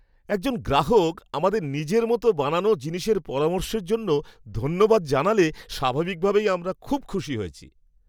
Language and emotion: Bengali, happy